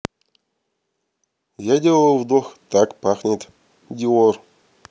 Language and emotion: Russian, neutral